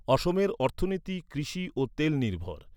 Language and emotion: Bengali, neutral